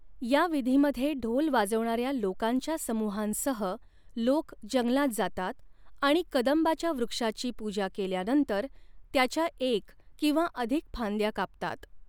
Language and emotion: Marathi, neutral